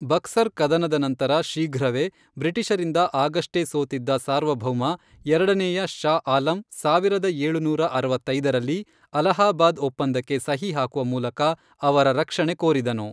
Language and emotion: Kannada, neutral